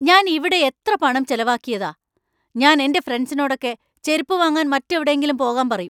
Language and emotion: Malayalam, angry